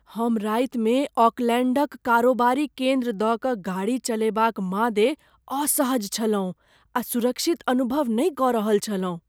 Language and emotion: Maithili, fearful